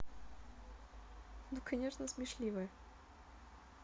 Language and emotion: Russian, positive